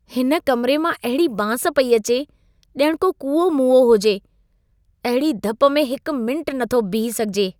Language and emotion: Sindhi, disgusted